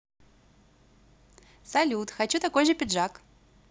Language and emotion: Russian, positive